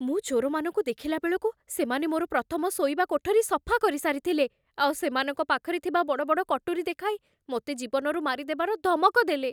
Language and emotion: Odia, fearful